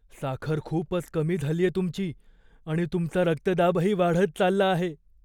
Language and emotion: Marathi, fearful